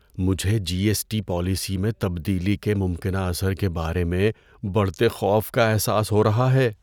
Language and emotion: Urdu, fearful